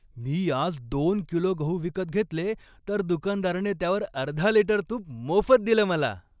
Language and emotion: Marathi, happy